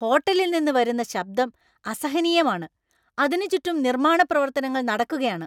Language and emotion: Malayalam, angry